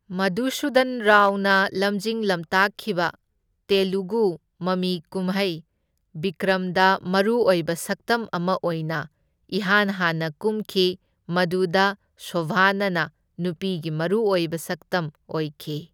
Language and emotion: Manipuri, neutral